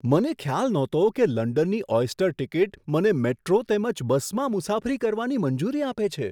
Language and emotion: Gujarati, surprised